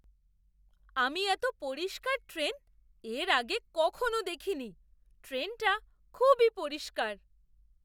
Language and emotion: Bengali, surprised